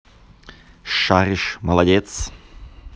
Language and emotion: Russian, positive